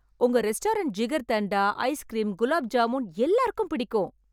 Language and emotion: Tamil, happy